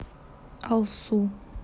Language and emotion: Russian, neutral